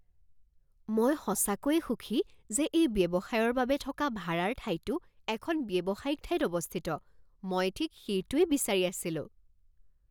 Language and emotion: Assamese, surprised